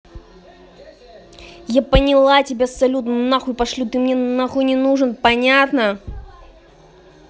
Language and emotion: Russian, angry